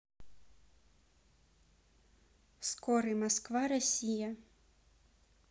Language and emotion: Russian, neutral